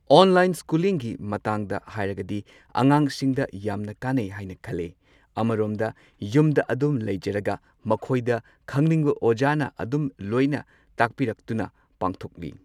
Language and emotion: Manipuri, neutral